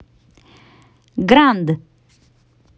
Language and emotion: Russian, positive